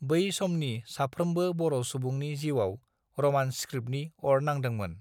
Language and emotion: Bodo, neutral